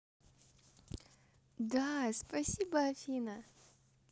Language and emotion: Russian, positive